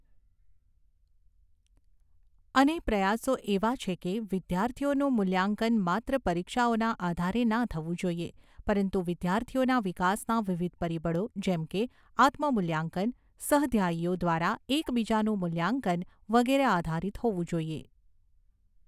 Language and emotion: Gujarati, neutral